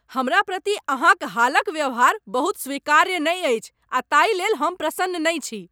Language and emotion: Maithili, angry